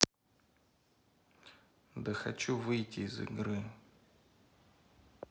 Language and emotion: Russian, neutral